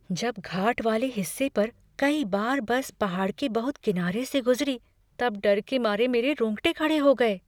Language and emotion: Hindi, fearful